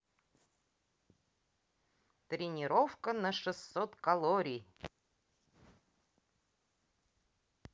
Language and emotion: Russian, neutral